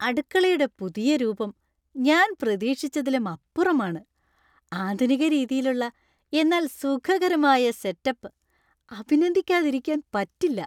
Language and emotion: Malayalam, happy